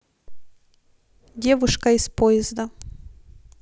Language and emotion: Russian, neutral